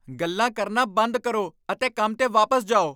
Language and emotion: Punjabi, angry